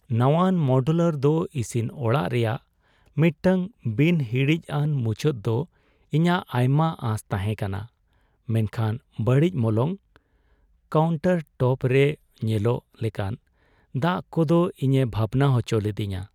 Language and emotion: Santali, sad